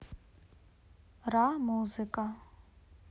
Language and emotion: Russian, neutral